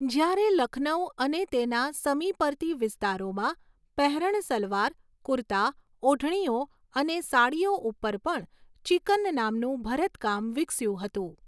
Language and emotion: Gujarati, neutral